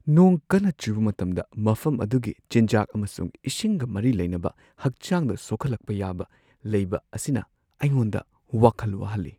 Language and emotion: Manipuri, fearful